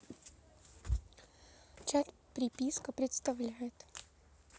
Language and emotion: Russian, neutral